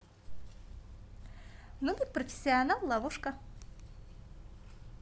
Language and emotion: Russian, positive